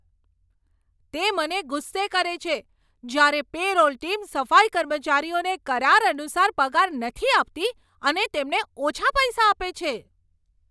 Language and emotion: Gujarati, angry